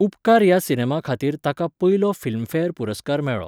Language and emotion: Goan Konkani, neutral